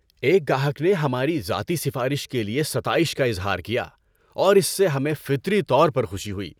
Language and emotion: Urdu, happy